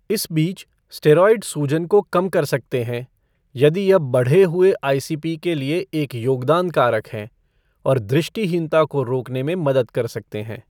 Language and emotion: Hindi, neutral